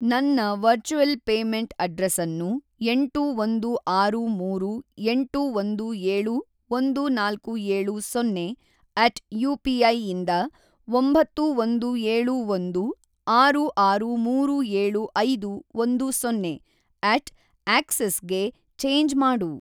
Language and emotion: Kannada, neutral